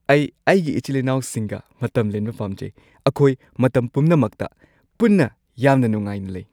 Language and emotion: Manipuri, happy